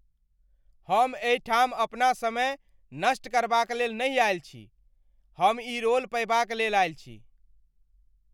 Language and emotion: Maithili, angry